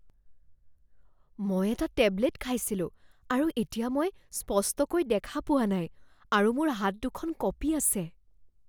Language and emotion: Assamese, fearful